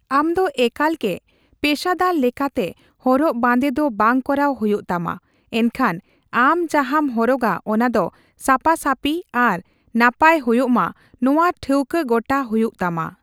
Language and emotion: Santali, neutral